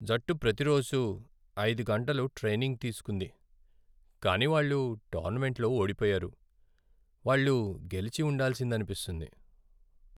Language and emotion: Telugu, sad